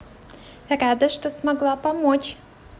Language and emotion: Russian, positive